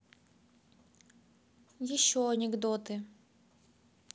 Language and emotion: Russian, neutral